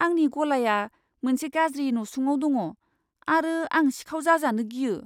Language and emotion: Bodo, fearful